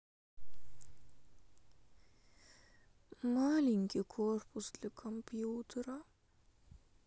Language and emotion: Russian, sad